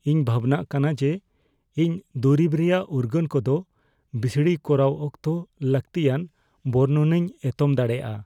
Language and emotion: Santali, fearful